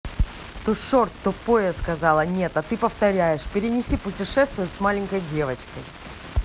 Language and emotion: Russian, angry